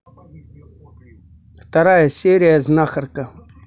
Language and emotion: Russian, neutral